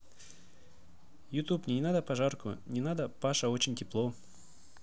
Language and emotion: Russian, neutral